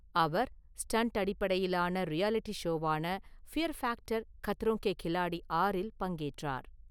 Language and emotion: Tamil, neutral